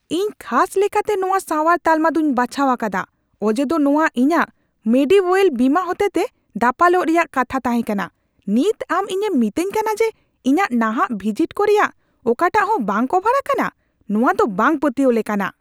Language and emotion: Santali, angry